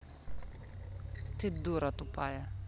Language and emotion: Russian, angry